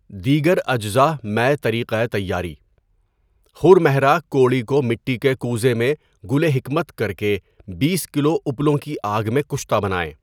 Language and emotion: Urdu, neutral